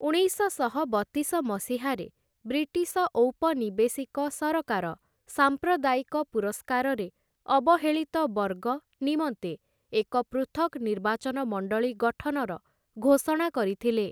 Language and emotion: Odia, neutral